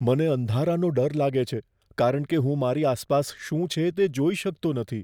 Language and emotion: Gujarati, fearful